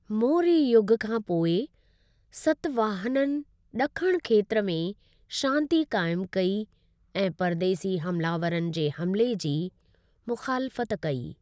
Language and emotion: Sindhi, neutral